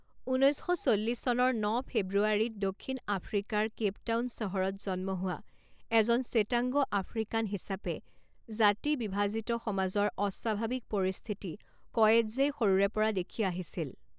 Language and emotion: Assamese, neutral